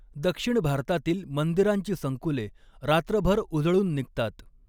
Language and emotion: Marathi, neutral